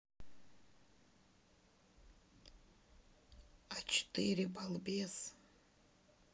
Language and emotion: Russian, sad